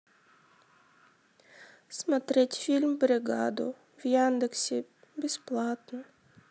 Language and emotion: Russian, sad